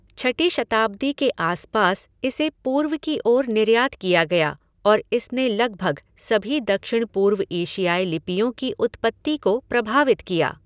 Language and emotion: Hindi, neutral